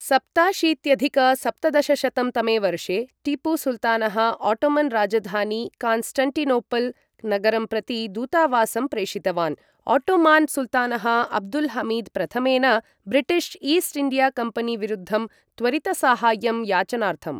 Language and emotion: Sanskrit, neutral